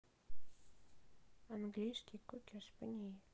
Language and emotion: Russian, sad